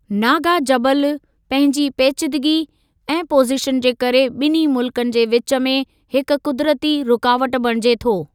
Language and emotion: Sindhi, neutral